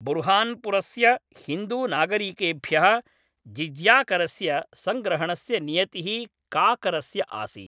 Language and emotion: Sanskrit, neutral